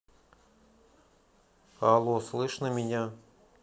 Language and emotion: Russian, neutral